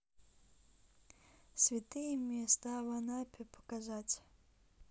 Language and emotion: Russian, neutral